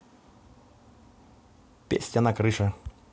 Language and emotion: Russian, neutral